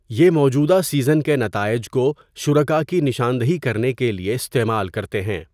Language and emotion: Urdu, neutral